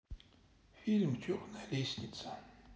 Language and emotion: Russian, sad